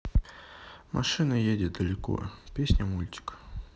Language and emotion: Russian, neutral